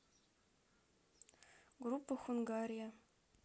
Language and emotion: Russian, neutral